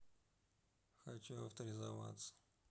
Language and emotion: Russian, neutral